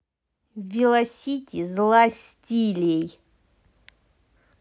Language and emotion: Russian, angry